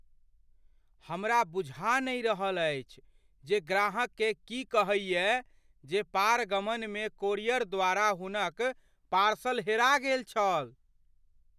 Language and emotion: Maithili, fearful